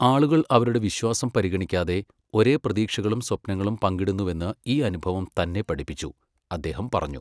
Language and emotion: Malayalam, neutral